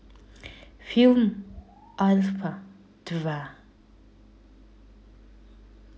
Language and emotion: Russian, neutral